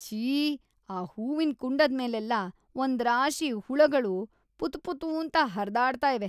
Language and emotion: Kannada, disgusted